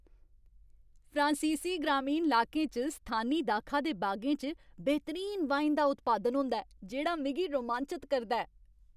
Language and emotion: Dogri, happy